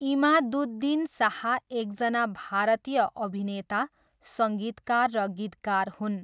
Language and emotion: Nepali, neutral